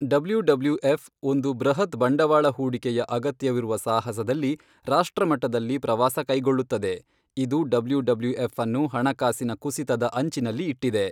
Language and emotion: Kannada, neutral